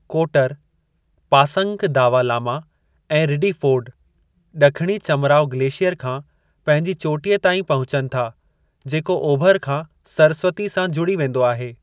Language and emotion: Sindhi, neutral